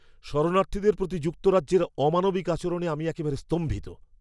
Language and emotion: Bengali, angry